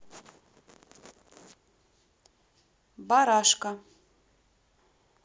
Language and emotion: Russian, neutral